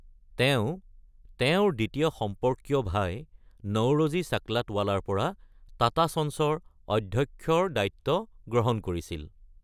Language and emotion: Assamese, neutral